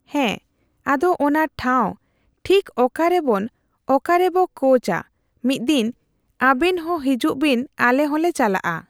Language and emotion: Santali, neutral